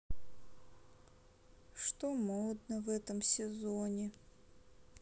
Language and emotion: Russian, sad